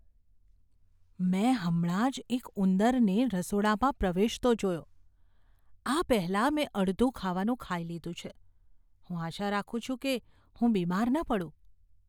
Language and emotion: Gujarati, fearful